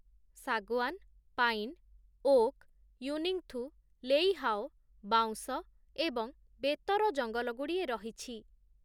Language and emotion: Odia, neutral